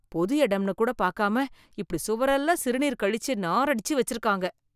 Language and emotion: Tamil, disgusted